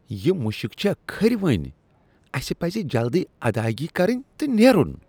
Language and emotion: Kashmiri, disgusted